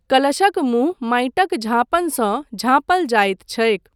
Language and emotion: Maithili, neutral